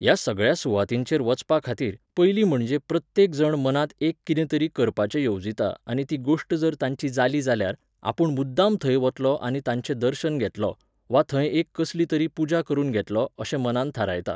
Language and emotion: Goan Konkani, neutral